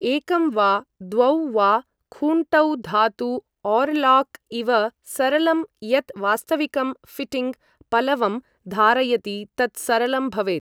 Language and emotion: Sanskrit, neutral